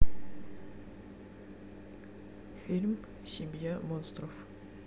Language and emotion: Russian, neutral